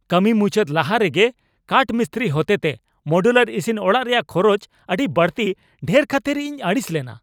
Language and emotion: Santali, angry